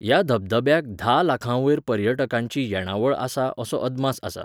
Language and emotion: Goan Konkani, neutral